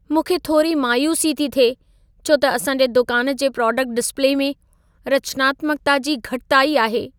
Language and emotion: Sindhi, sad